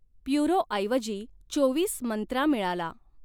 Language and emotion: Marathi, neutral